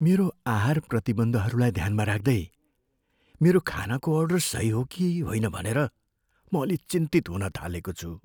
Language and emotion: Nepali, fearful